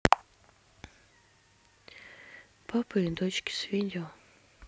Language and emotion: Russian, sad